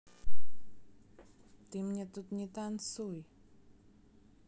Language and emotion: Russian, neutral